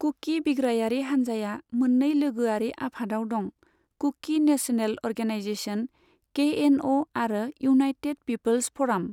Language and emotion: Bodo, neutral